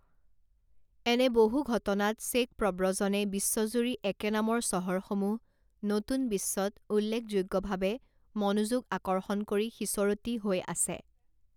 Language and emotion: Assamese, neutral